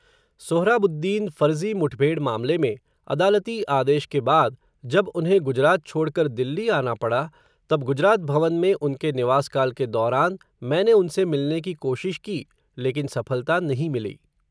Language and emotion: Hindi, neutral